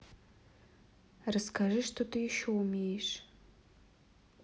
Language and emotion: Russian, neutral